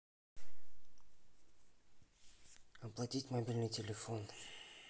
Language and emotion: Russian, neutral